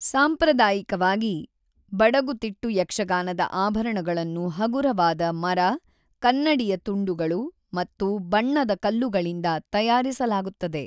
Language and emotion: Kannada, neutral